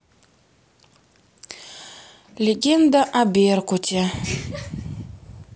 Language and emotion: Russian, neutral